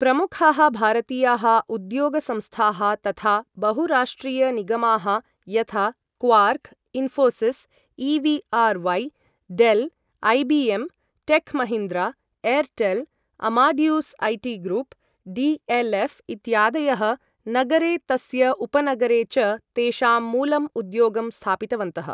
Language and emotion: Sanskrit, neutral